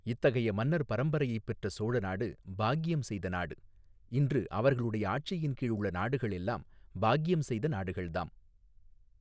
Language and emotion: Tamil, neutral